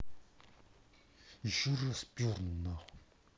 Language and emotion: Russian, angry